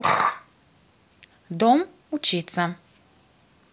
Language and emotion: Russian, neutral